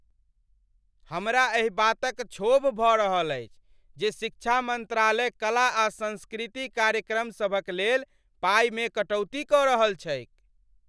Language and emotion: Maithili, angry